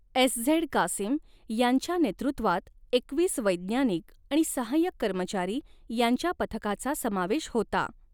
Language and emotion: Marathi, neutral